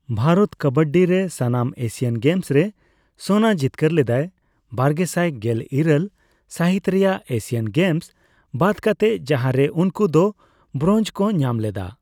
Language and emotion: Santali, neutral